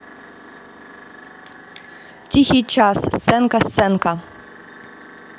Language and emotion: Russian, neutral